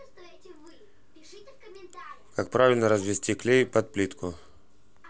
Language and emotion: Russian, neutral